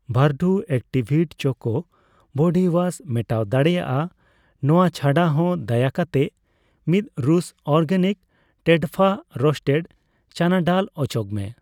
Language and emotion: Santali, neutral